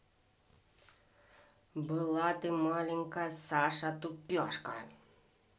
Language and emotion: Russian, angry